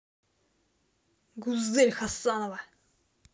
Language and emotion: Russian, angry